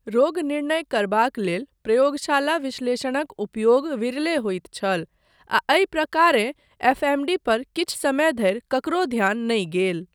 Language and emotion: Maithili, neutral